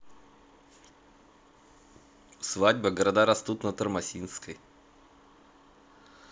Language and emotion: Russian, neutral